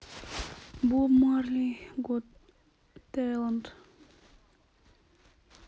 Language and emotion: Russian, neutral